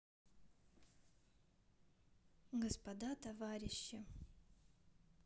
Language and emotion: Russian, neutral